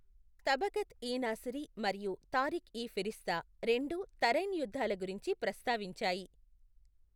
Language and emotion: Telugu, neutral